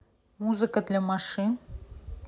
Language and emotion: Russian, neutral